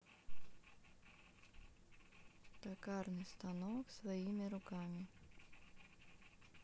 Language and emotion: Russian, neutral